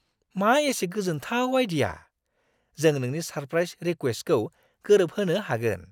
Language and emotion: Bodo, surprised